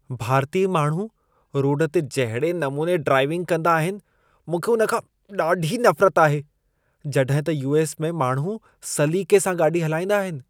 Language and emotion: Sindhi, disgusted